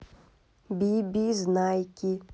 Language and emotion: Russian, neutral